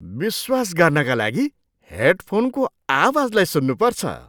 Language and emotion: Nepali, surprised